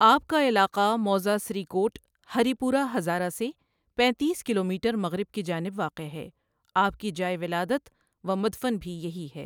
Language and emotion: Urdu, neutral